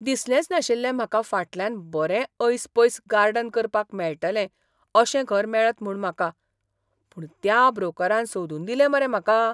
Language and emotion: Goan Konkani, surprised